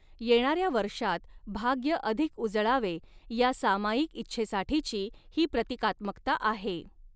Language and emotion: Marathi, neutral